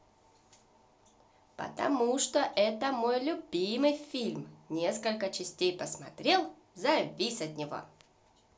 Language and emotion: Russian, positive